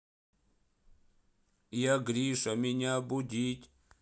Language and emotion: Russian, sad